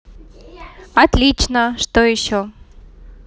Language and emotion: Russian, positive